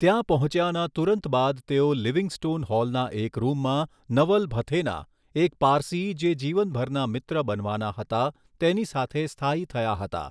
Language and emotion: Gujarati, neutral